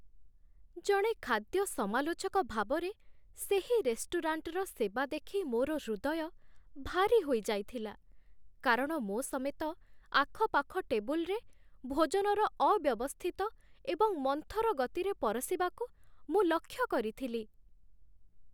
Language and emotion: Odia, sad